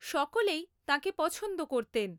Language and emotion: Bengali, neutral